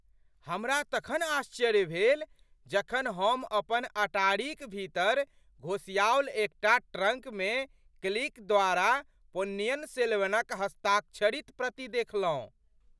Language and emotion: Maithili, surprised